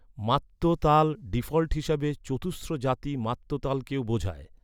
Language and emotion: Bengali, neutral